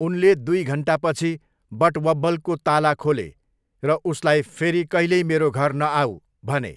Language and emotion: Nepali, neutral